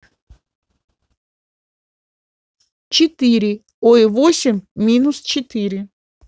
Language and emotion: Russian, neutral